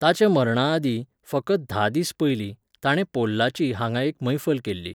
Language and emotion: Goan Konkani, neutral